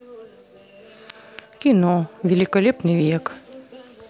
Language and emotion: Russian, neutral